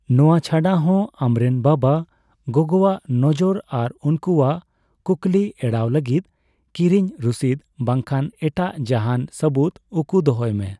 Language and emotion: Santali, neutral